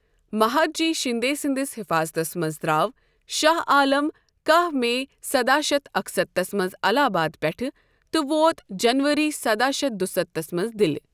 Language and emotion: Kashmiri, neutral